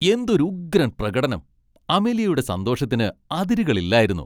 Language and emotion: Malayalam, happy